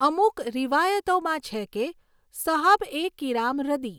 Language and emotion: Gujarati, neutral